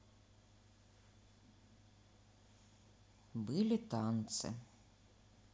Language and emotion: Russian, neutral